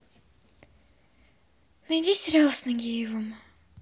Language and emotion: Russian, neutral